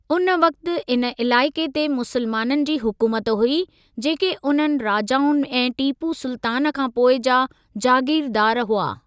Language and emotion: Sindhi, neutral